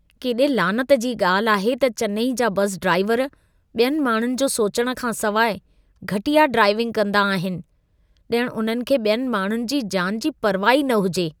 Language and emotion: Sindhi, disgusted